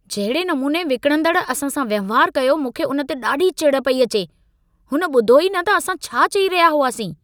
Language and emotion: Sindhi, angry